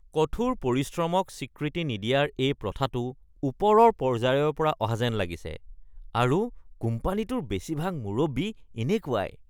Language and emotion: Assamese, disgusted